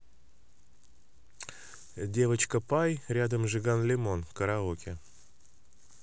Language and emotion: Russian, neutral